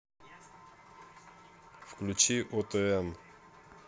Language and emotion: Russian, neutral